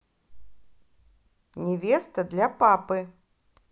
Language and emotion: Russian, positive